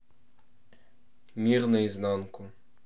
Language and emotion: Russian, neutral